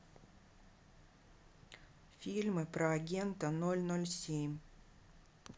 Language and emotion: Russian, neutral